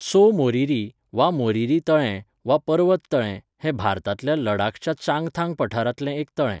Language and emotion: Goan Konkani, neutral